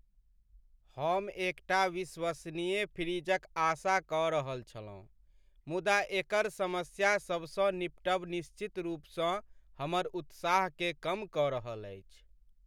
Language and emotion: Maithili, sad